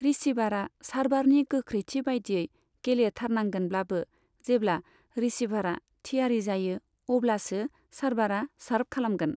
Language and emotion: Bodo, neutral